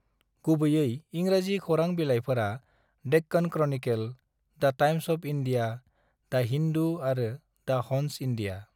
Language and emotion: Bodo, neutral